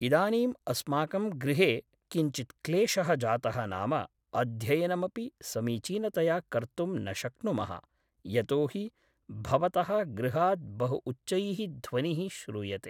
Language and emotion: Sanskrit, neutral